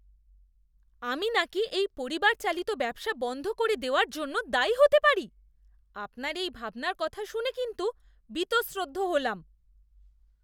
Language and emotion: Bengali, disgusted